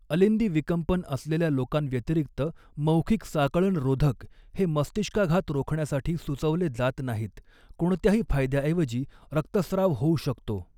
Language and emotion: Marathi, neutral